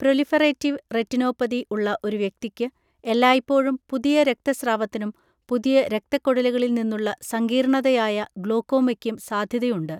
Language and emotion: Malayalam, neutral